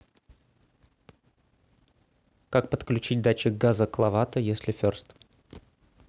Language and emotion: Russian, neutral